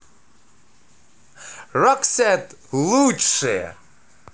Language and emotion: Russian, positive